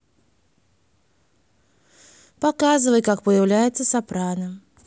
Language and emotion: Russian, neutral